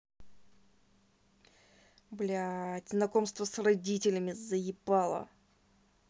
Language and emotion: Russian, angry